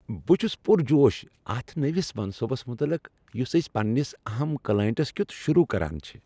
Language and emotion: Kashmiri, happy